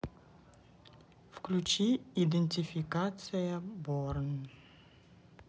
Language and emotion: Russian, neutral